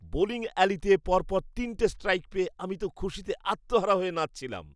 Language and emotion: Bengali, happy